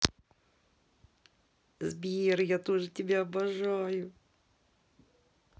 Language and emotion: Russian, positive